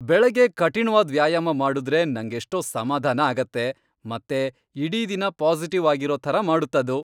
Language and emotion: Kannada, happy